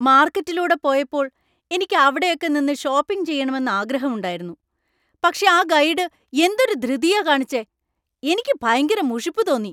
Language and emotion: Malayalam, angry